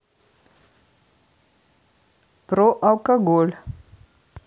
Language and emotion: Russian, neutral